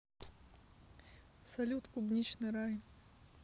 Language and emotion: Russian, neutral